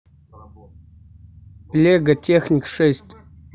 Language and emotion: Russian, neutral